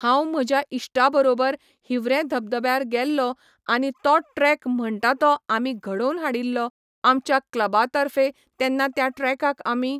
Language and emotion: Goan Konkani, neutral